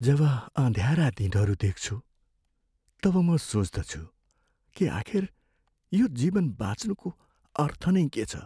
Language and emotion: Nepali, sad